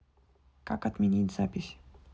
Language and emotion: Russian, neutral